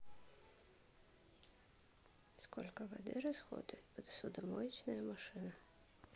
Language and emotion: Russian, neutral